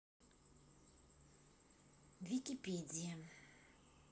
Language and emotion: Russian, neutral